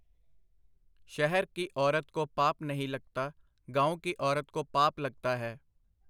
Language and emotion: Punjabi, neutral